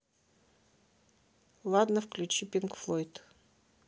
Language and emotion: Russian, neutral